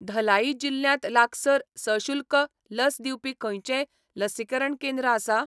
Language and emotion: Goan Konkani, neutral